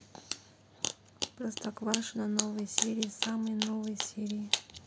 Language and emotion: Russian, neutral